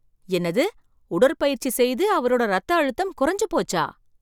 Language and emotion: Tamil, surprised